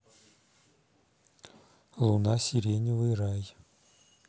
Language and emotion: Russian, neutral